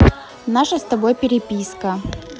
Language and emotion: Russian, neutral